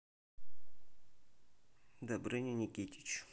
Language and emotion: Russian, neutral